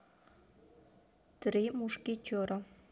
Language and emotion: Russian, neutral